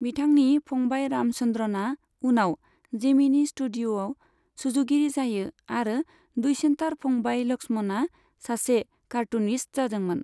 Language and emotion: Bodo, neutral